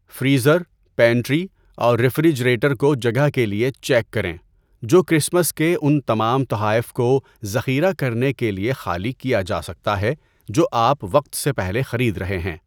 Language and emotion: Urdu, neutral